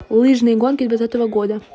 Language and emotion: Russian, neutral